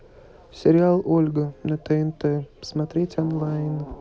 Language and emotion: Russian, neutral